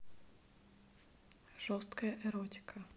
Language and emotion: Russian, neutral